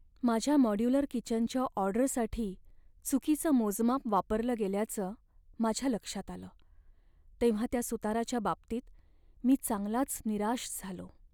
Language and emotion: Marathi, sad